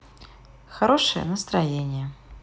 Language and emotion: Russian, positive